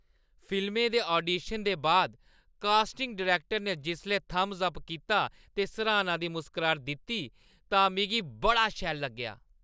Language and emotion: Dogri, happy